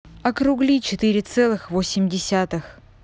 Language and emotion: Russian, neutral